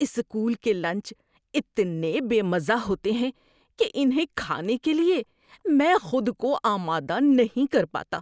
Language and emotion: Urdu, disgusted